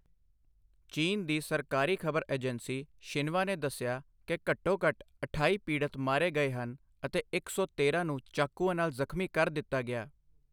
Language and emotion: Punjabi, neutral